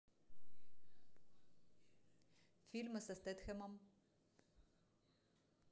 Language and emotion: Russian, neutral